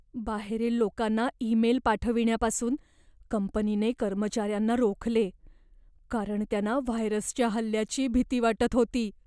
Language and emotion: Marathi, fearful